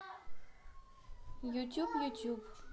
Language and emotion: Russian, neutral